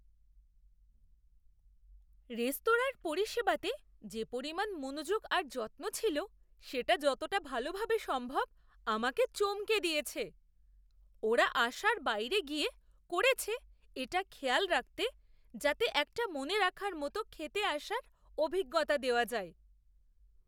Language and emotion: Bengali, surprised